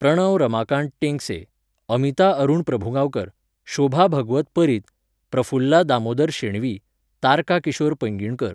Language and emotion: Goan Konkani, neutral